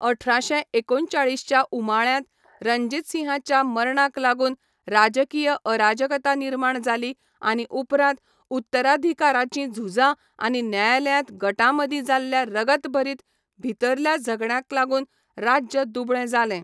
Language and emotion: Goan Konkani, neutral